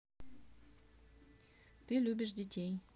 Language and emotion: Russian, neutral